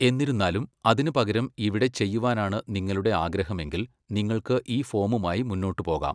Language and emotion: Malayalam, neutral